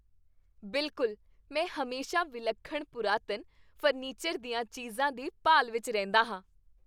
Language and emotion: Punjabi, happy